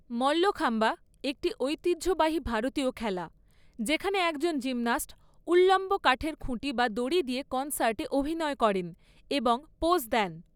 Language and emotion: Bengali, neutral